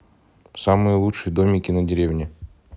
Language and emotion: Russian, neutral